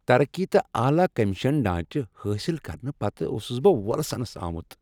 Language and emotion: Kashmiri, happy